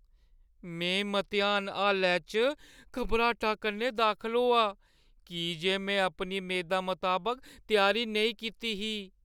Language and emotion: Dogri, fearful